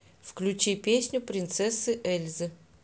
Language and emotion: Russian, neutral